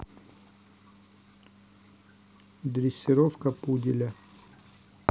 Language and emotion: Russian, neutral